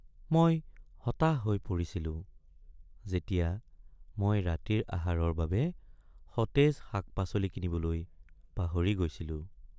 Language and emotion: Assamese, sad